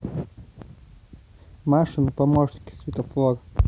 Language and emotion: Russian, neutral